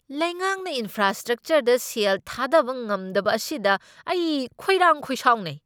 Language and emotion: Manipuri, angry